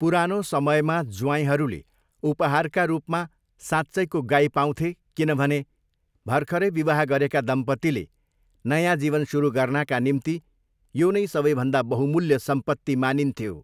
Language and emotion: Nepali, neutral